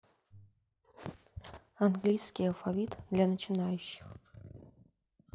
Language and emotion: Russian, neutral